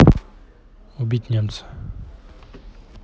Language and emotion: Russian, neutral